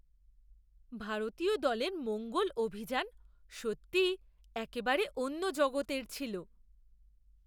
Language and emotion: Bengali, surprised